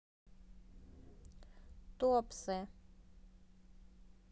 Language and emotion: Russian, neutral